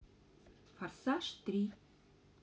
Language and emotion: Russian, neutral